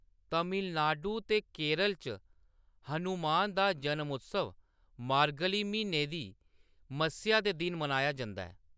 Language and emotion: Dogri, neutral